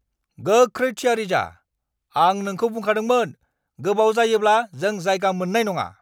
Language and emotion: Bodo, angry